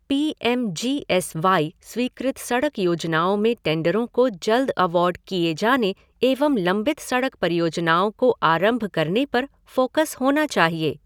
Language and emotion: Hindi, neutral